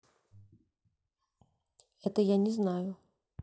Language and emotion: Russian, neutral